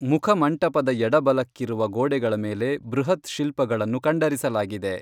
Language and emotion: Kannada, neutral